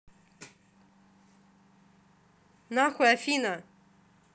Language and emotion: Russian, angry